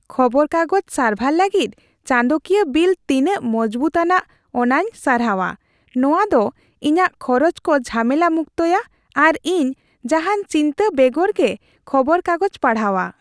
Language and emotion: Santali, happy